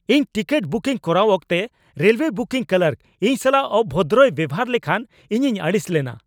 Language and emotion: Santali, angry